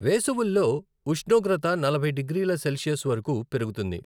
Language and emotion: Telugu, neutral